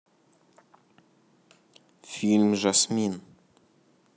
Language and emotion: Russian, neutral